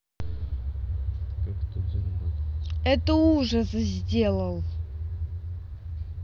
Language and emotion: Russian, angry